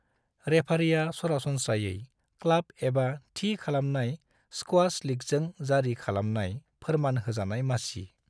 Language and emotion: Bodo, neutral